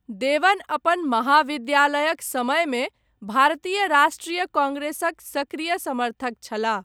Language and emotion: Maithili, neutral